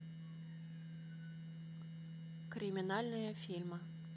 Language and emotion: Russian, neutral